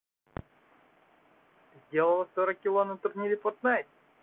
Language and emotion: Russian, neutral